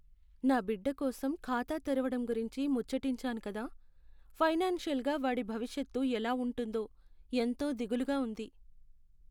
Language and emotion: Telugu, sad